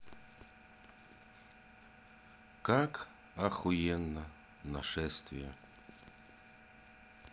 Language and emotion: Russian, neutral